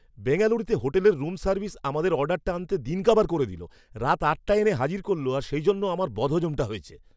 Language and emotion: Bengali, angry